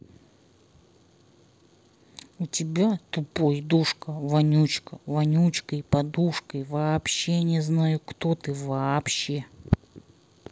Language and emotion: Russian, angry